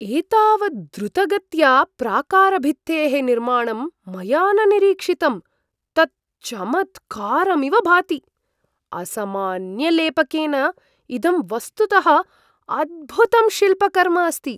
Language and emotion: Sanskrit, surprised